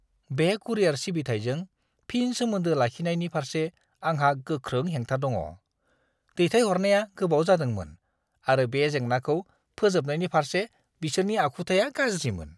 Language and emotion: Bodo, disgusted